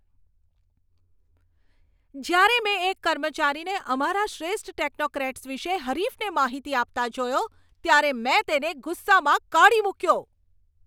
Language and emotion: Gujarati, angry